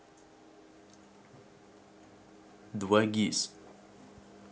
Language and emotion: Russian, neutral